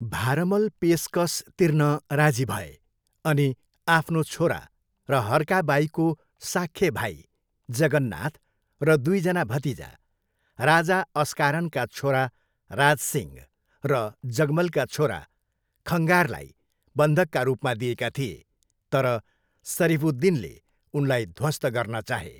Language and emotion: Nepali, neutral